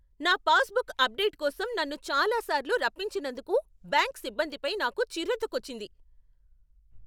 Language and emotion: Telugu, angry